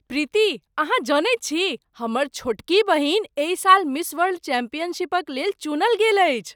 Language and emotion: Maithili, surprised